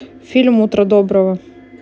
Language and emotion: Russian, neutral